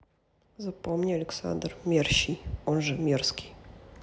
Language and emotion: Russian, neutral